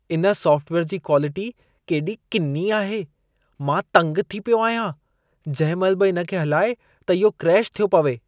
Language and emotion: Sindhi, disgusted